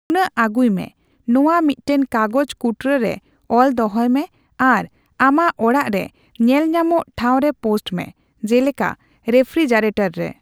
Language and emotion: Santali, neutral